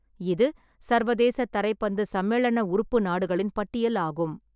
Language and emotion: Tamil, neutral